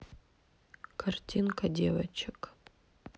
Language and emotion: Russian, sad